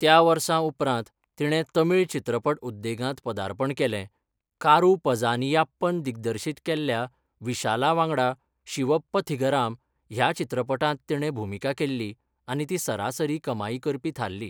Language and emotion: Goan Konkani, neutral